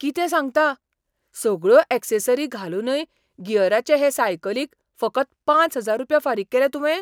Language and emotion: Goan Konkani, surprised